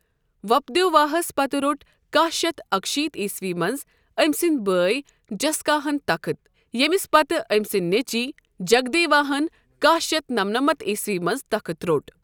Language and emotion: Kashmiri, neutral